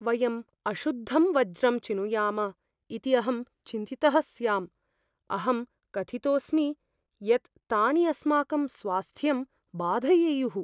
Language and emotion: Sanskrit, fearful